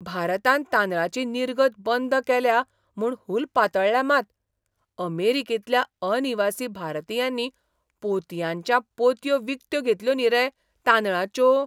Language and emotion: Goan Konkani, surprised